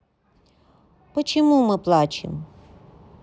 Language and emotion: Russian, neutral